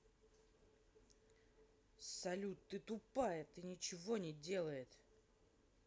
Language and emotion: Russian, angry